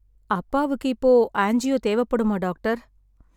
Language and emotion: Tamil, sad